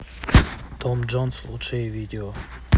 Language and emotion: Russian, neutral